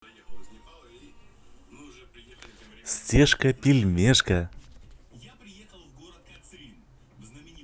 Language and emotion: Russian, positive